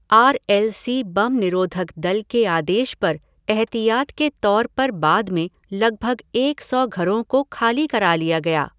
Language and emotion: Hindi, neutral